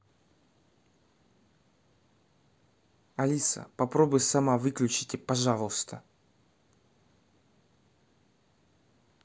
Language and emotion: Russian, angry